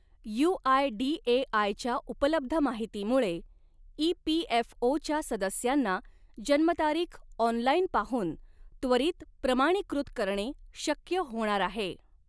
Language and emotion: Marathi, neutral